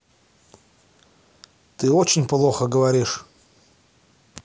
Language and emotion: Russian, angry